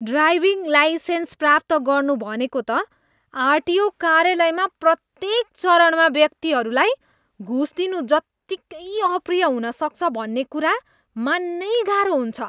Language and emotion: Nepali, disgusted